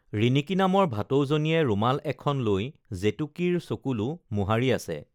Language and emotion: Assamese, neutral